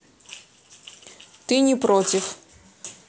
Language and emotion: Russian, neutral